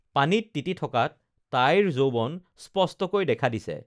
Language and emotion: Assamese, neutral